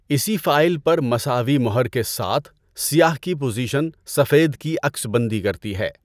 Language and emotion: Urdu, neutral